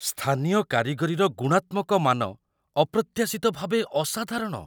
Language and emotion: Odia, surprised